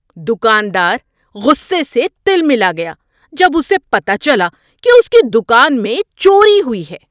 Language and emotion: Urdu, angry